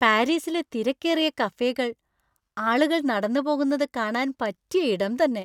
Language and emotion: Malayalam, happy